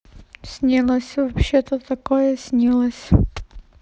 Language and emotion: Russian, neutral